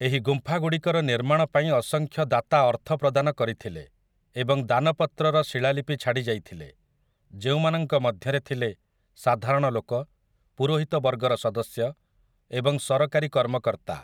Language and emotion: Odia, neutral